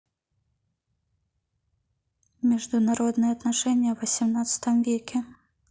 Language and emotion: Russian, neutral